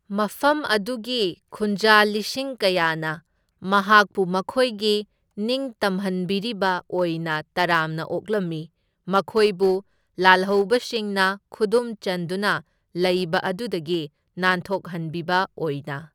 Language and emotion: Manipuri, neutral